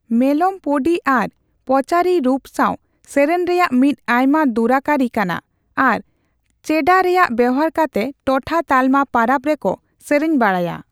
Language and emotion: Santali, neutral